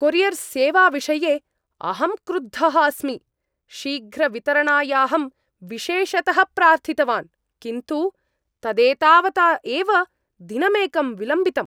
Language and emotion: Sanskrit, angry